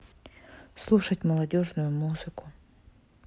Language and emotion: Russian, sad